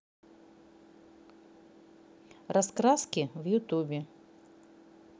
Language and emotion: Russian, neutral